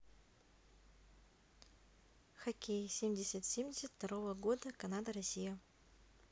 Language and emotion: Russian, neutral